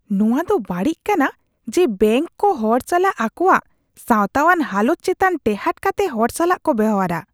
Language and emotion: Santali, disgusted